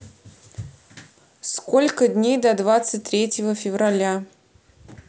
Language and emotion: Russian, neutral